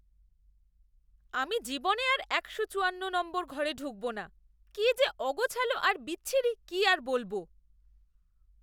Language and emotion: Bengali, disgusted